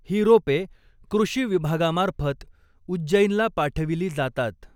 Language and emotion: Marathi, neutral